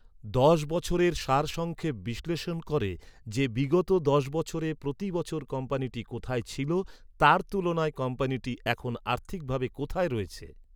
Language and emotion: Bengali, neutral